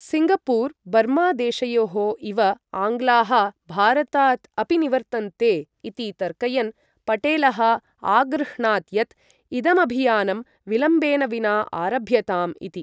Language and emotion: Sanskrit, neutral